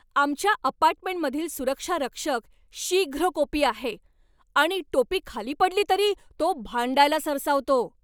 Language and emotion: Marathi, angry